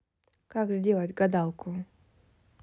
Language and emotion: Russian, neutral